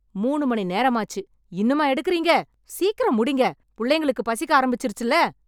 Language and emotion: Tamil, angry